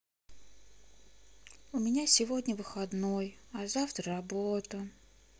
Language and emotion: Russian, sad